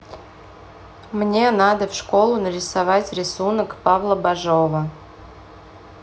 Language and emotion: Russian, neutral